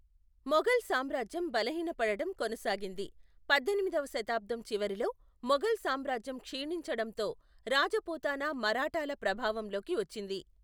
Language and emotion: Telugu, neutral